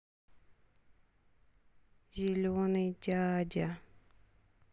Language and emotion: Russian, sad